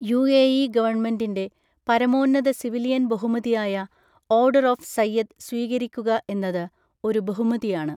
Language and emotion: Malayalam, neutral